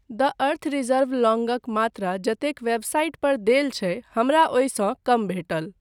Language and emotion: Maithili, neutral